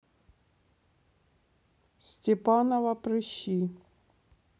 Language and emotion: Russian, neutral